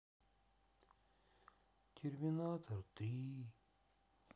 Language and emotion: Russian, sad